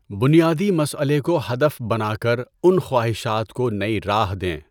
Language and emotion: Urdu, neutral